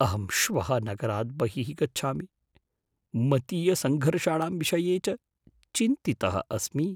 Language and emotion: Sanskrit, fearful